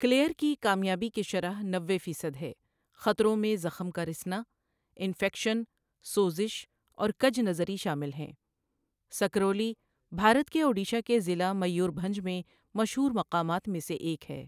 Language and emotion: Urdu, neutral